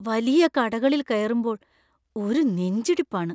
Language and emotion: Malayalam, fearful